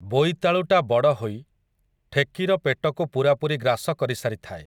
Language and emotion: Odia, neutral